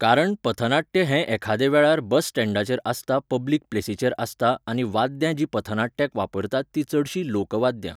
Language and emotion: Goan Konkani, neutral